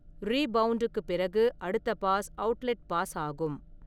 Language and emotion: Tamil, neutral